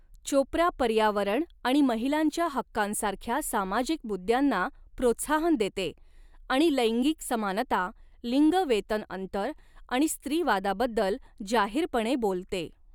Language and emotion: Marathi, neutral